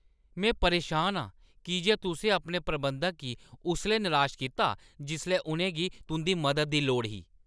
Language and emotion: Dogri, angry